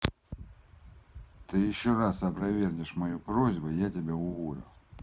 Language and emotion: Russian, angry